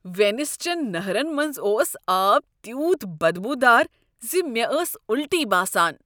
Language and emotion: Kashmiri, disgusted